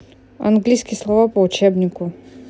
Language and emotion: Russian, neutral